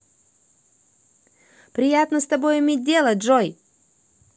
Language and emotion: Russian, positive